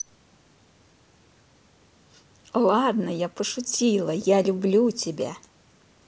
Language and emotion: Russian, positive